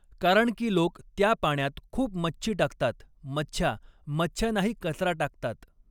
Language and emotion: Marathi, neutral